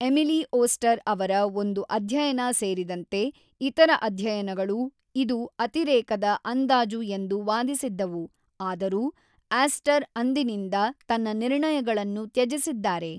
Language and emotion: Kannada, neutral